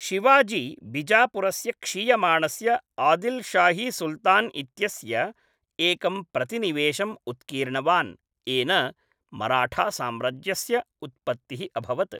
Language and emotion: Sanskrit, neutral